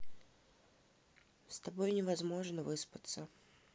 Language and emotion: Russian, neutral